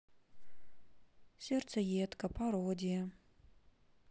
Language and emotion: Russian, sad